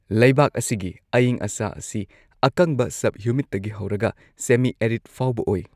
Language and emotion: Manipuri, neutral